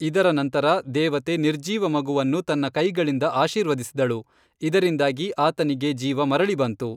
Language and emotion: Kannada, neutral